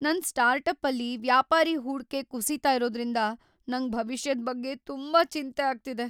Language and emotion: Kannada, fearful